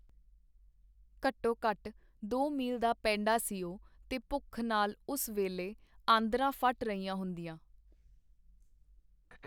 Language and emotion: Punjabi, neutral